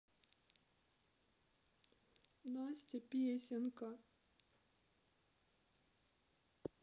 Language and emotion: Russian, sad